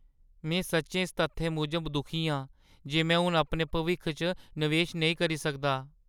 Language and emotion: Dogri, sad